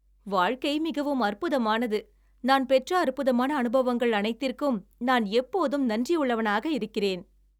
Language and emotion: Tamil, happy